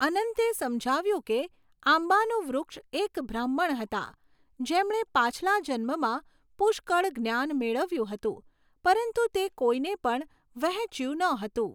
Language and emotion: Gujarati, neutral